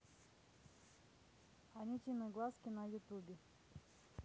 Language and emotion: Russian, neutral